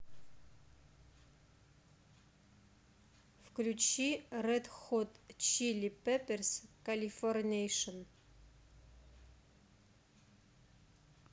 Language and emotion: Russian, neutral